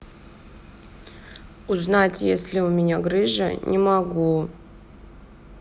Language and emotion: Russian, sad